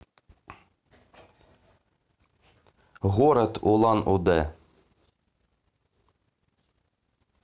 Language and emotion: Russian, neutral